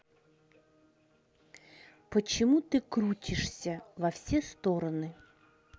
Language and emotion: Russian, angry